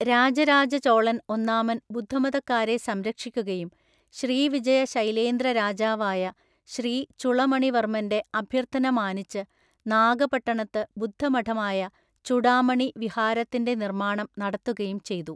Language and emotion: Malayalam, neutral